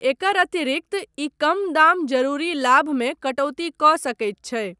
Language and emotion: Maithili, neutral